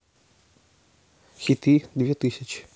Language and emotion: Russian, neutral